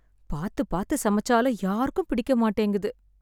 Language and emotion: Tamil, sad